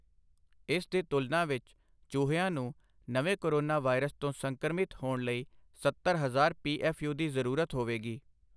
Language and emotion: Punjabi, neutral